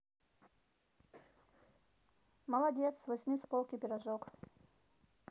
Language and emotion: Russian, neutral